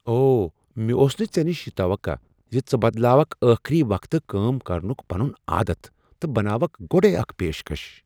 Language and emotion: Kashmiri, surprised